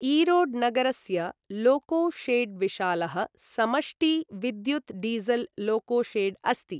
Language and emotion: Sanskrit, neutral